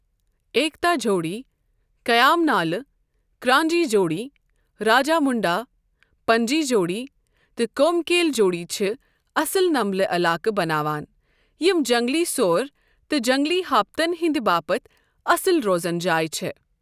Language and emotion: Kashmiri, neutral